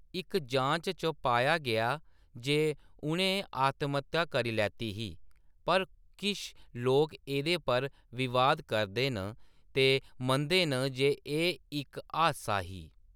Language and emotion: Dogri, neutral